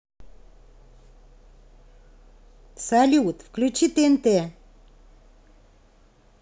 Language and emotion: Russian, positive